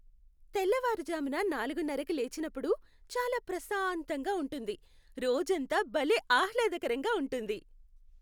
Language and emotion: Telugu, happy